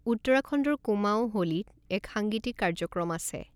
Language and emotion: Assamese, neutral